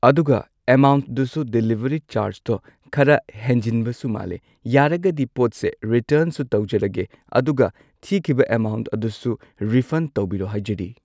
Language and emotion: Manipuri, neutral